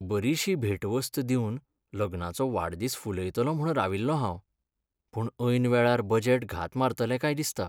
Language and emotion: Goan Konkani, sad